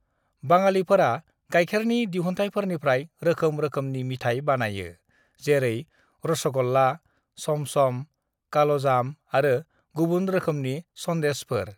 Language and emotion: Bodo, neutral